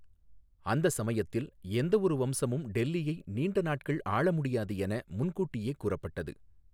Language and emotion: Tamil, neutral